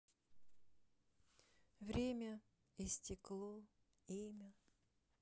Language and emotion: Russian, sad